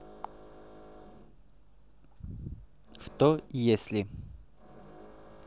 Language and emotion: Russian, neutral